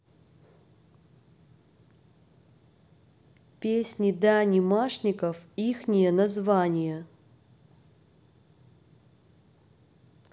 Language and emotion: Russian, neutral